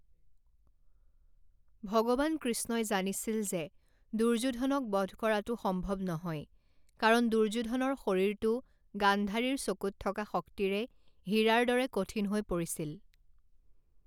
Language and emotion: Assamese, neutral